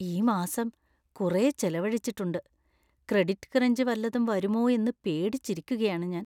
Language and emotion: Malayalam, fearful